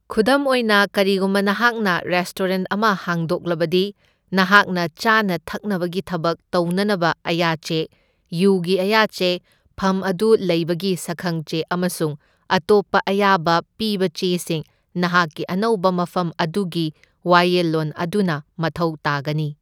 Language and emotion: Manipuri, neutral